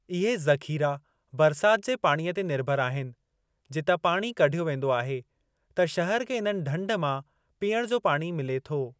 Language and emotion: Sindhi, neutral